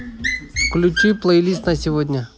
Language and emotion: Russian, neutral